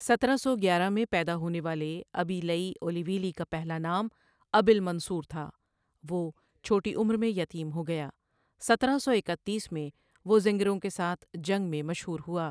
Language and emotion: Urdu, neutral